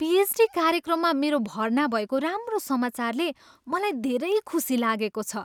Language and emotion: Nepali, happy